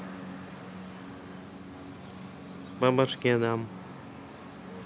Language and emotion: Russian, neutral